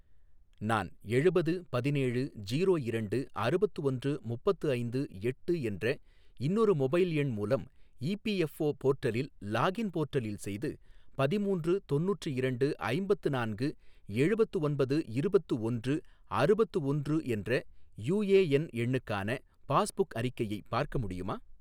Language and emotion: Tamil, neutral